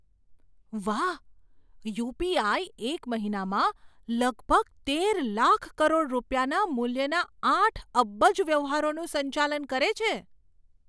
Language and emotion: Gujarati, surprised